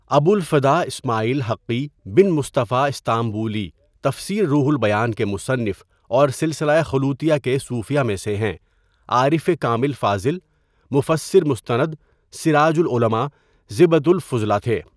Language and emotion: Urdu, neutral